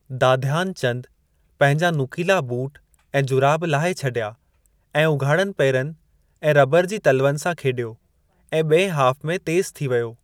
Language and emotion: Sindhi, neutral